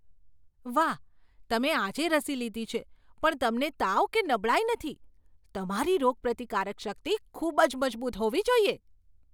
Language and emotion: Gujarati, surprised